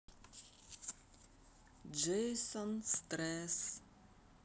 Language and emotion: Russian, neutral